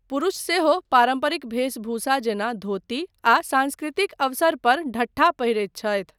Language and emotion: Maithili, neutral